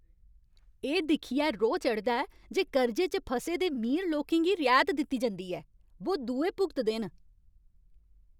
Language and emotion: Dogri, angry